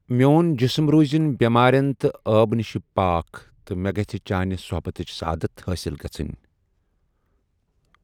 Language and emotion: Kashmiri, neutral